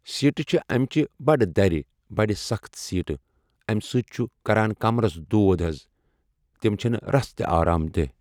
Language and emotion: Kashmiri, neutral